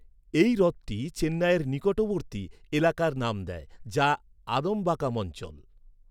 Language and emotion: Bengali, neutral